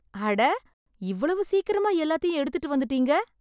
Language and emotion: Tamil, surprised